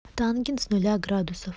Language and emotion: Russian, neutral